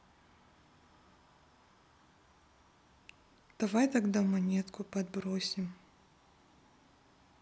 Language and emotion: Russian, neutral